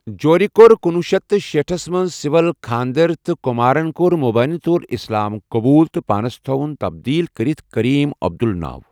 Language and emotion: Kashmiri, neutral